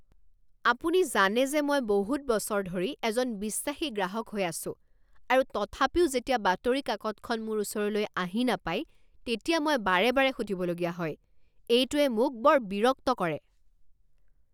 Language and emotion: Assamese, angry